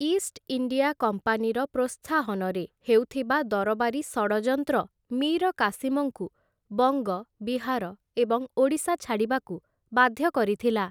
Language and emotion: Odia, neutral